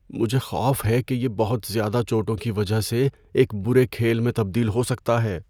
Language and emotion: Urdu, fearful